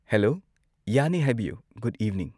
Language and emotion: Manipuri, neutral